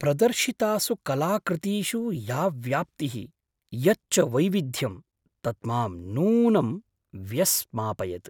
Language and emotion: Sanskrit, surprised